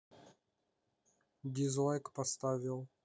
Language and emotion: Russian, neutral